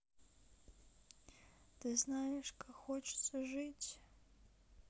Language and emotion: Russian, sad